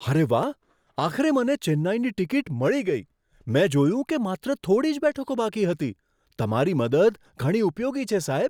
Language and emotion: Gujarati, surprised